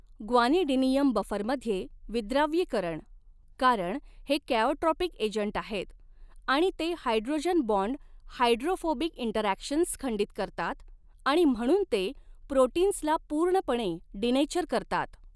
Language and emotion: Marathi, neutral